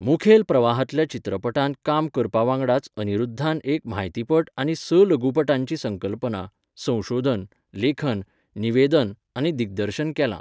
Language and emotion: Goan Konkani, neutral